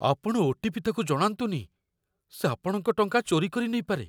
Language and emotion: Odia, fearful